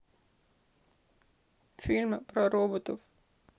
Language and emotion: Russian, sad